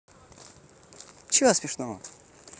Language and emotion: Russian, neutral